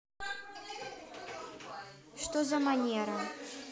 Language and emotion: Russian, neutral